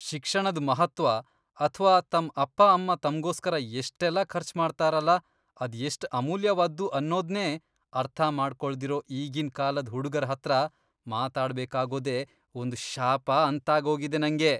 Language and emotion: Kannada, disgusted